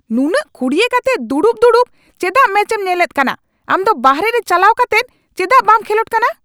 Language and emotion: Santali, angry